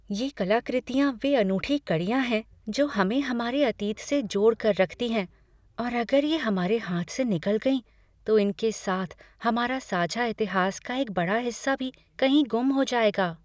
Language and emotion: Hindi, fearful